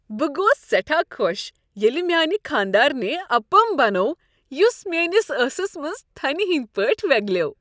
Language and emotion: Kashmiri, happy